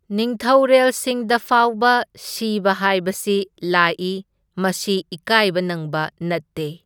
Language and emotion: Manipuri, neutral